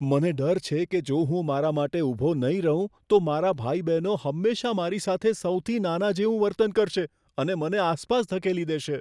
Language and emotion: Gujarati, fearful